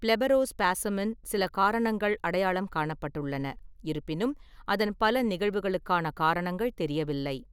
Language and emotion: Tamil, neutral